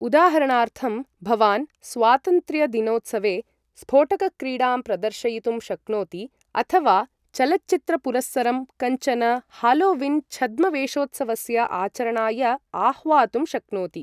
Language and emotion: Sanskrit, neutral